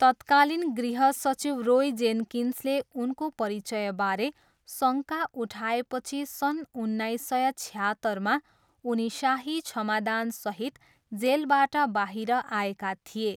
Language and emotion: Nepali, neutral